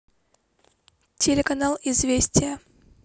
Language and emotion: Russian, neutral